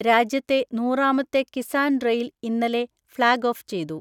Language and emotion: Malayalam, neutral